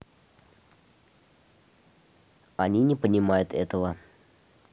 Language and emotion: Russian, neutral